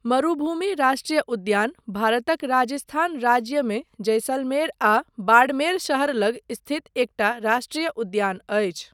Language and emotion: Maithili, neutral